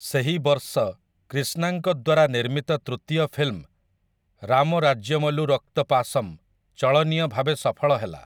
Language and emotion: Odia, neutral